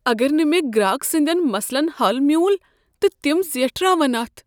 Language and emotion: Kashmiri, fearful